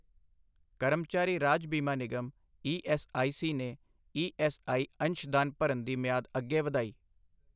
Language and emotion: Punjabi, neutral